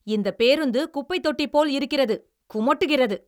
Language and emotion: Tamil, angry